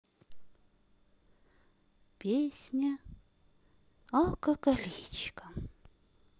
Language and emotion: Russian, neutral